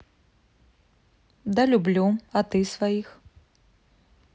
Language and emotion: Russian, neutral